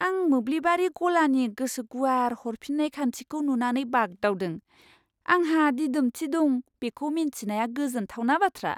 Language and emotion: Bodo, surprised